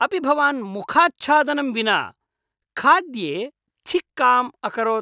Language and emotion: Sanskrit, disgusted